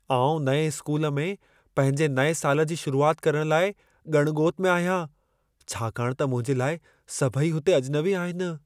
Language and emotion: Sindhi, fearful